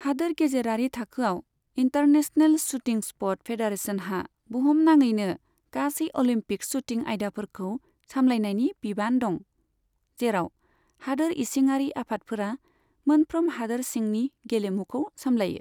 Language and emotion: Bodo, neutral